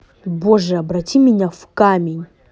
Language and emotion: Russian, angry